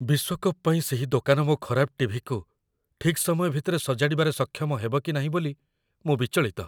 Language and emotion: Odia, fearful